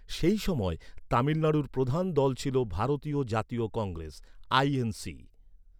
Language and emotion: Bengali, neutral